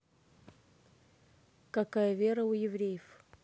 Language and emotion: Russian, neutral